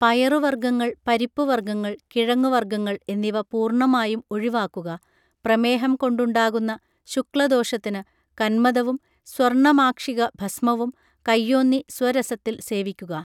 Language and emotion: Malayalam, neutral